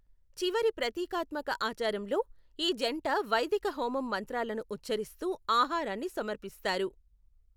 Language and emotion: Telugu, neutral